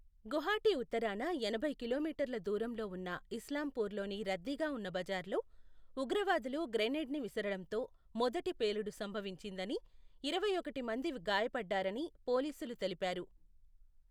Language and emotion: Telugu, neutral